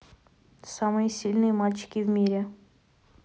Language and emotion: Russian, neutral